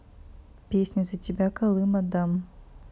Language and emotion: Russian, neutral